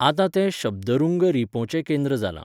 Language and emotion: Goan Konkani, neutral